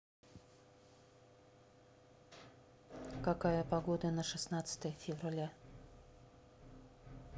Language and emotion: Russian, neutral